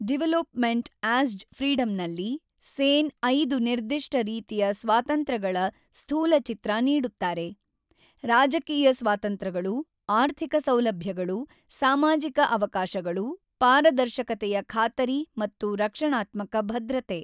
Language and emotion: Kannada, neutral